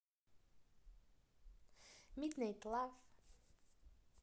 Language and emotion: Russian, neutral